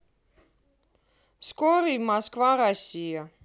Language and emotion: Russian, neutral